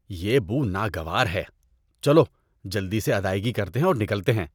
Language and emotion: Urdu, disgusted